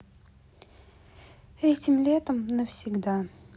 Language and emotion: Russian, sad